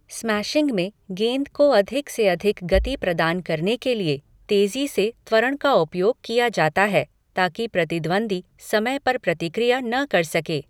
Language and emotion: Hindi, neutral